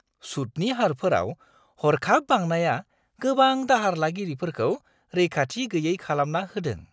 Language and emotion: Bodo, surprised